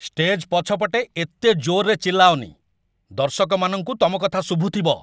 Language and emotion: Odia, angry